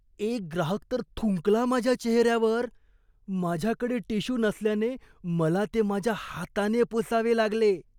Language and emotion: Marathi, disgusted